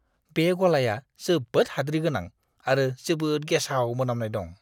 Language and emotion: Bodo, disgusted